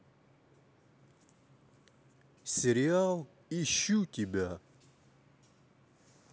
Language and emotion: Russian, neutral